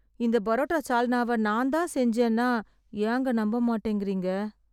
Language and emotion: Tamil, sad